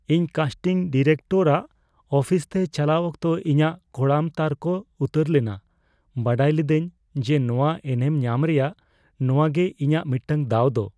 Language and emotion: Santali, fearful